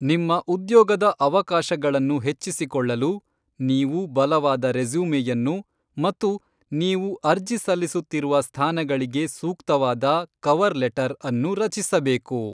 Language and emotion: Kannada, neutral